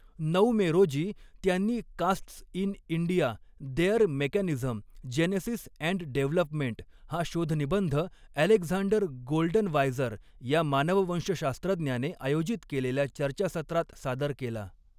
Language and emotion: Marathi, neutral